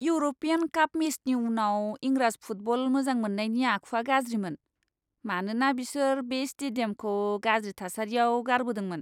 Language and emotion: Bodo, disgusted